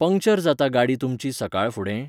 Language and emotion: Goan Konkani, neutral